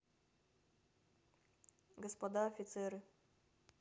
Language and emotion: Russian, neutral